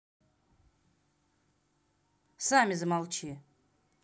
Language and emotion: Russian, angry